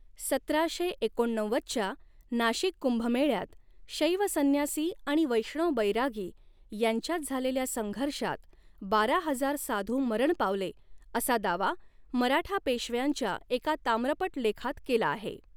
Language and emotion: Marathi, neutral